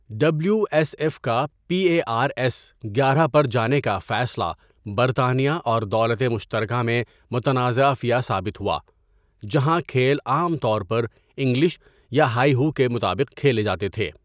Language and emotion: Urdu, neutral